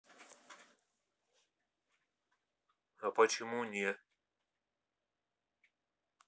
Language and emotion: Russian, neutral